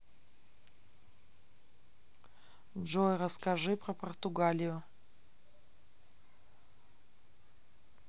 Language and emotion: Russian, neutral